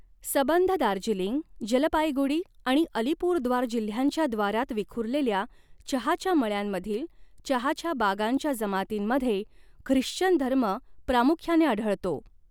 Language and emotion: Marathi, neutral